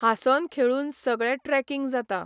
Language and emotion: Goan Konkani, neutral